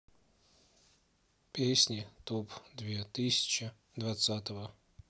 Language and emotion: Russian, sad